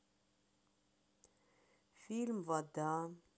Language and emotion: Russian, sad